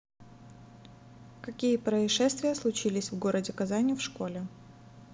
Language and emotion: Russian, neutral